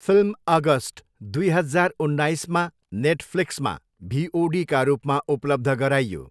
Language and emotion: Nepali, neutral